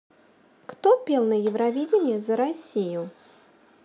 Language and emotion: Russian, neutral